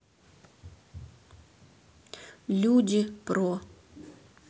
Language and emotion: Russian, neutral